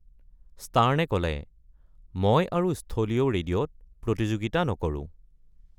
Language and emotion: Assamese, neutral